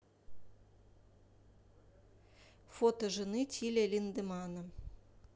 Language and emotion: Russian, neutral